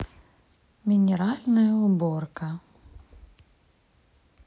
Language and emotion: Russian, neutral